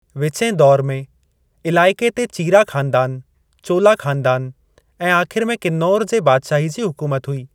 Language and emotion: Sindhi, neutral